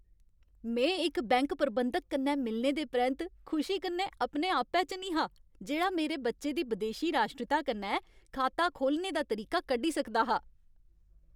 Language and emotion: Dogri, happy